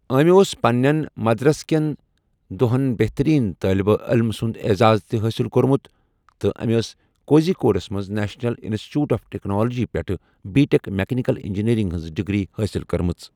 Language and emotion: Kashmiri, neutral